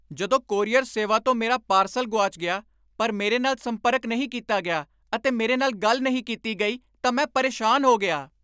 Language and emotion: Punjabi, angry